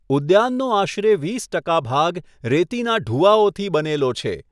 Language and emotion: Gujarati, neutral